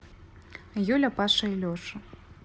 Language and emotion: Russian, neutral